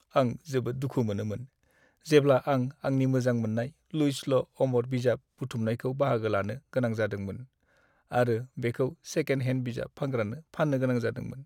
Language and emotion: Bodo, sad